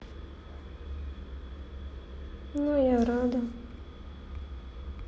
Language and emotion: Russian, sad